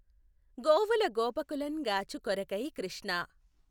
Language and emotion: Telugu, neutral